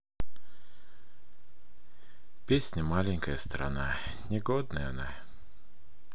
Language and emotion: Russian, sad